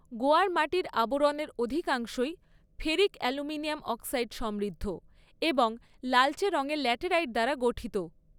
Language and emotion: Bengali, neutral